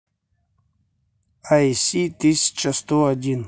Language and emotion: Russian, neutral